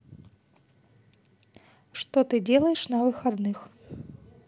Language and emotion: Russian, neutral